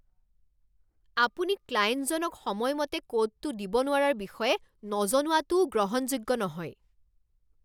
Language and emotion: Assamese, angry